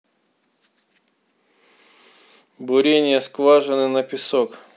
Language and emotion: Russian, neutral